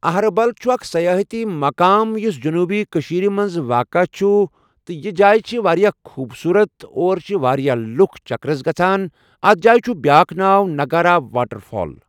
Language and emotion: Kashmiri, neutral